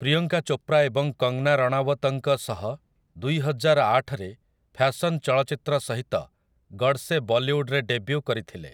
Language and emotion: Odia, neutral